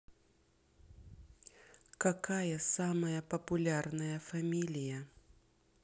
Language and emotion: Russian, neutral